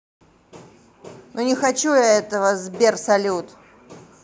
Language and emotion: Russian, angry